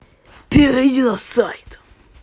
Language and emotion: Russian, angry